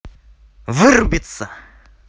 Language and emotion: Russian, angry